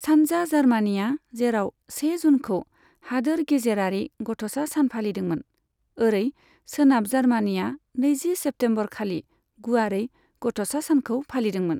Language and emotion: Bodo, neutral